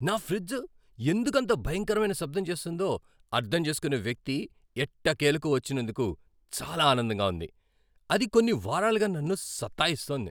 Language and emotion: Telugu, happy